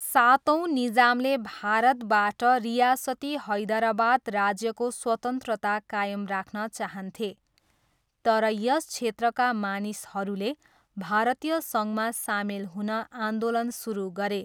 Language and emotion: Nepali, neutral